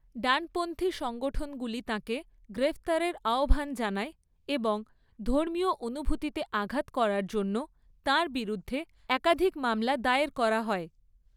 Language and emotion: Bengali, neutral